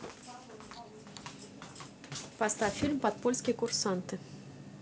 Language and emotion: Russian, neutral